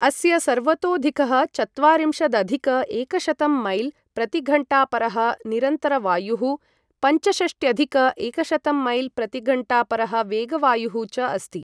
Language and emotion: Sanskrit, neutral